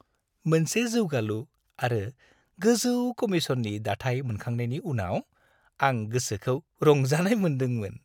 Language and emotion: Bodo, happy